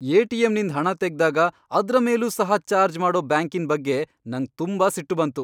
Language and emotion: Kannada, angry